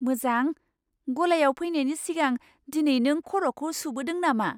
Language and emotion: Bodo, surprised